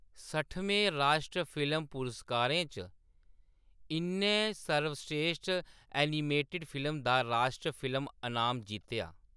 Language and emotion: Dogri, neutral